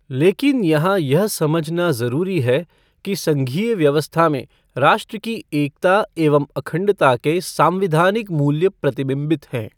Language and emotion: Hindi, neutral